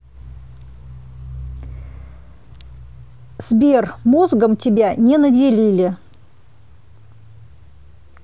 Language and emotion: Russian, angry